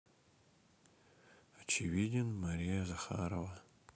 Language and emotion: Russian, sad